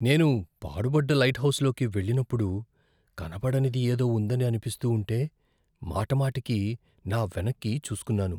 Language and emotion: Telugu, fearful